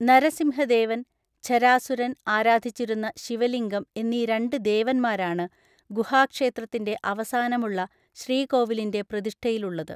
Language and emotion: Malayalam, neutral